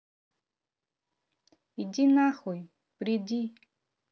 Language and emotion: Russian, neutral